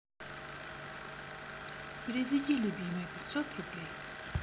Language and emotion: Russian, neutral